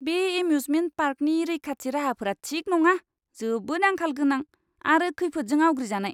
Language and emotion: Bodo, disgusted